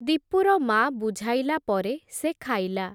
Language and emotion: Odia, neutral